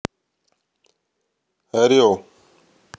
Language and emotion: Russian, neutral